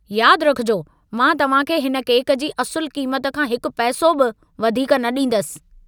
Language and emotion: Sindhi, angry